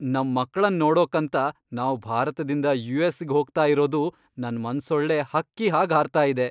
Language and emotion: Kannada, happy